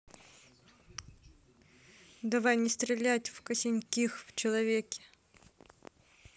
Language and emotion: Russian, neutral